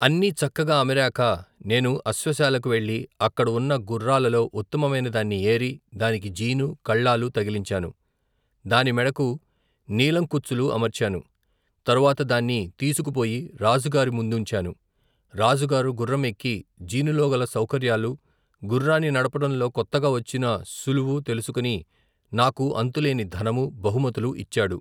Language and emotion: Telugu, neutral